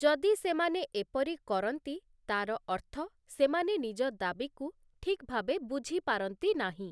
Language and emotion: Odia, neutral